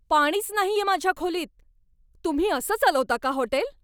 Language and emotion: Marathi, angry